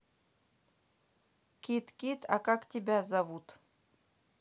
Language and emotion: Russian, neutral